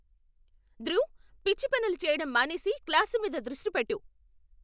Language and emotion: Telugu, angry